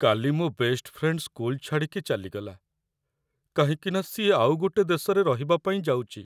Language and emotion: Odia, sad